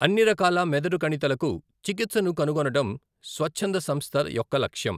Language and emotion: Telugu, neutral